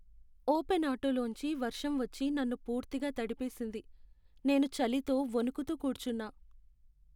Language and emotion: Telugu, sad